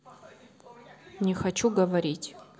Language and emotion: Russian, neutral